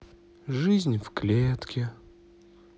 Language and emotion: Russian, sad